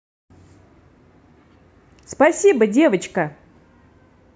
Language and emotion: Russian, positive